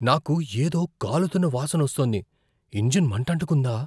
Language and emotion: Telugu, fearful